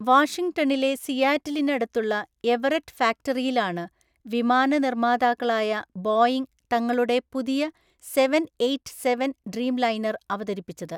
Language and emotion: Malayalam, neutral